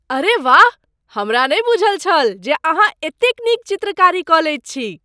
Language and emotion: Maithili, surprised